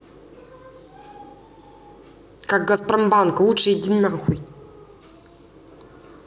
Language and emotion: Russian, angry